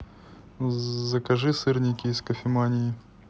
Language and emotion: Russian, neutral